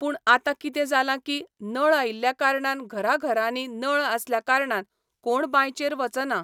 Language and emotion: Goan Konkani, neutral